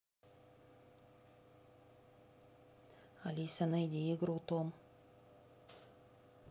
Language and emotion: Russian, neutral